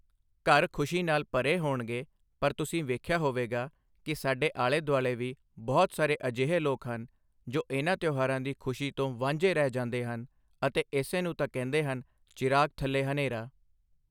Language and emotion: Punjabi, neutral